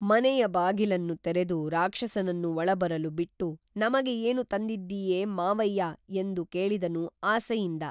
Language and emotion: Kannada, neutral